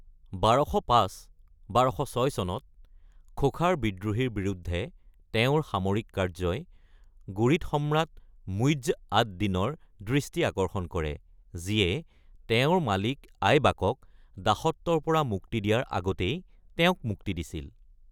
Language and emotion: Assamese, neutral